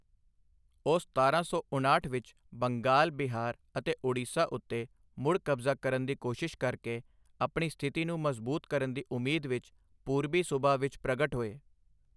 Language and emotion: Punjabi, neutral